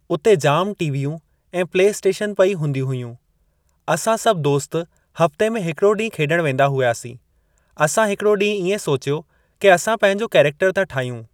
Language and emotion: Sindhi, neutral